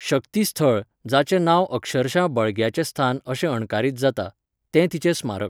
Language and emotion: Goan Konkani, neutral